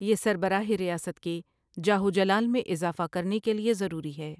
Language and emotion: Urdu, neutral